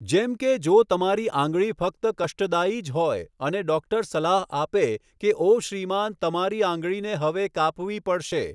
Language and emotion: Gujarati, neutral